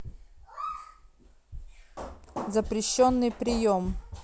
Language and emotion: Russian, neutral